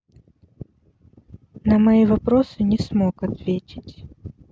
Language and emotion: Russian, sad